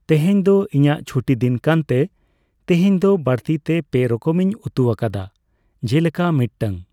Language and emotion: Santali, neutral